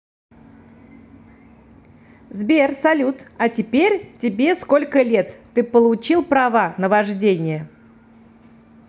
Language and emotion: Russian, positive